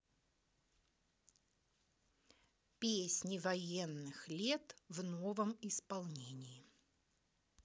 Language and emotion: Russian, neutral